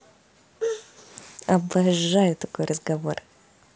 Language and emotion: Russian, positive